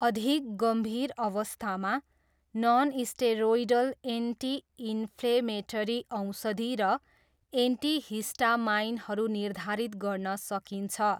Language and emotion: Nepali, neutral